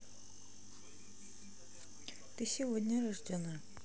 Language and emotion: Russian, neutral